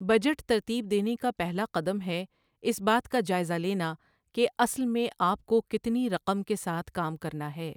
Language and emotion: Urdu, neutral